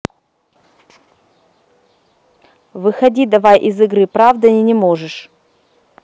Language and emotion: Russian, angry